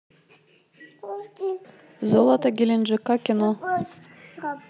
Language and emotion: Russian, neutral